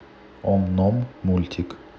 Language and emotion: Russian, neutral